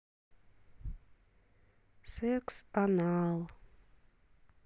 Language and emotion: Russian, sad